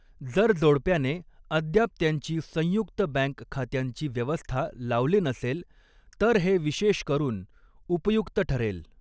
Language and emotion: Marathi, neutral